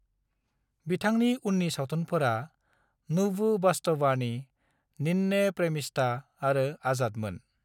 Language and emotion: Bodo, neutral